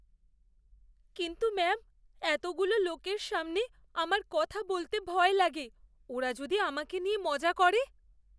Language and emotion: Bengali, fearful